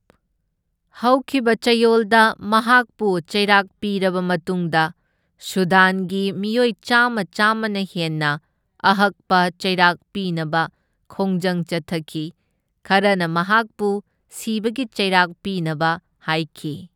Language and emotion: Manipuri, neutral